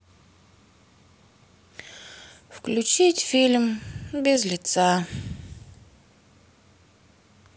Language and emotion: Russian, sad